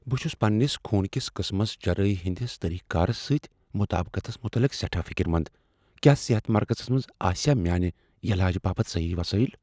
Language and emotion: Kashmiri, fearful